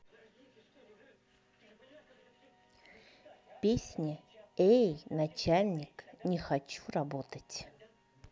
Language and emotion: Russian, neutral